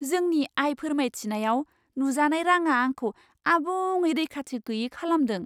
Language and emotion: Bodo, surprised